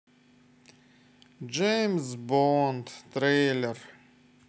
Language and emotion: Russian, sad